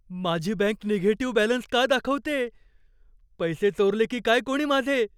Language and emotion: Marathi, fearful